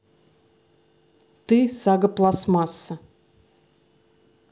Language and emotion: Russian, neutral